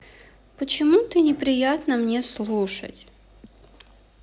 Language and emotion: Russian, sad